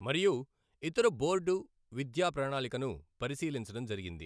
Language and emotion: Telugu, neutral